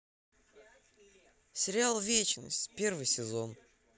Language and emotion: Russian, neutral